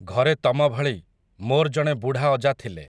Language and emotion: Odia, neutral